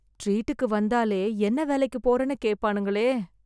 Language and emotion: Tamil, fearful